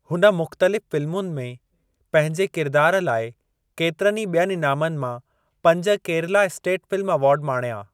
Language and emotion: Sindhi, neutral